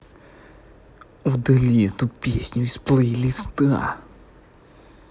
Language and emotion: Russian, angry